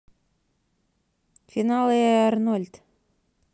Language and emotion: Russian, neutral